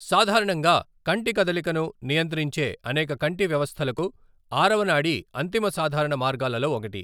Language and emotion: Telugu, neutral